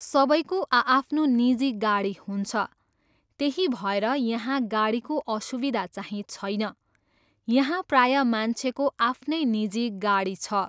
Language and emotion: Nepali, neutral